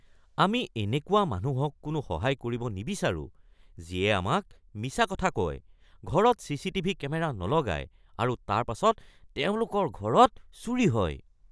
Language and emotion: Assamese, disgusted